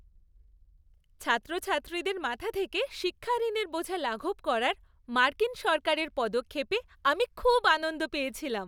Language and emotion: Bengali, happy